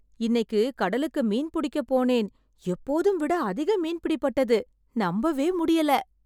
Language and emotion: Tamil, surprised